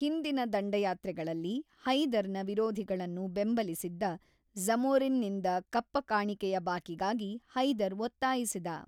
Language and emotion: Kannada, neutral